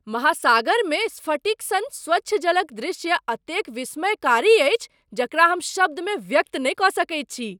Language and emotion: Maithili, surprised